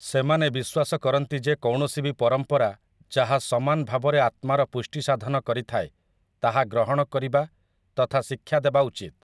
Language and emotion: Odia, neutral